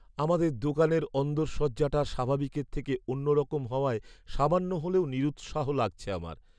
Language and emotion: Bengali, sad